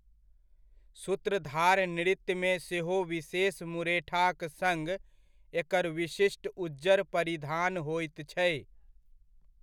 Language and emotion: Maithili, neutral